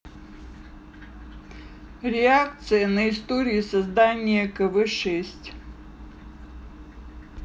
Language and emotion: Russian, neutral